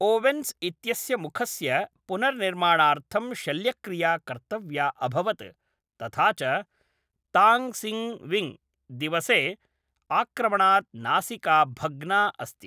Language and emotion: Sanskrit, neutral